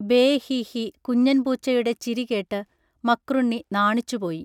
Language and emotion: Malayalam, neutral